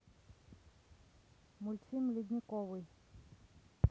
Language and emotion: Russian, neutral